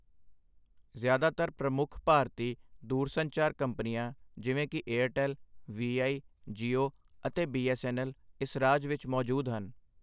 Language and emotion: Punjabi, neutral